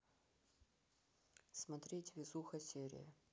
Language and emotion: Russian, neutral